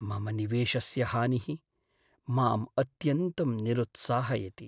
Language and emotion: Sanskrit, sad